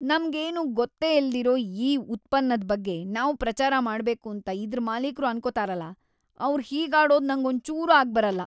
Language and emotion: Kannada, disgusted